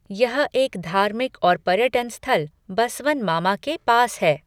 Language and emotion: Hindi, neutral